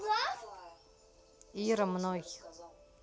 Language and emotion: Russian, neutral